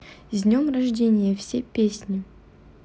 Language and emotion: Russian, neutral